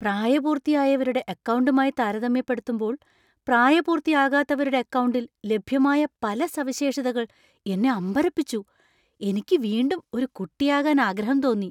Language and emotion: Malayalam, surprised